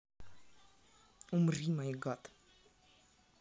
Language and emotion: Russian, neutral